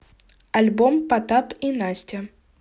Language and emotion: Russian, neutral